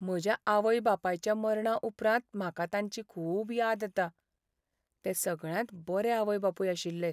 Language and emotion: Goan Konkani, sad